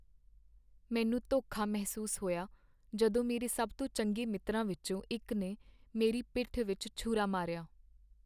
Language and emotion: Punjabi, sad